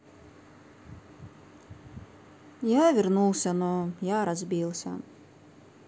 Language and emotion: Russian, sad